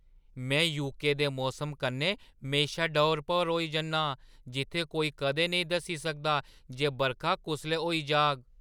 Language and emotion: Dogri, surprised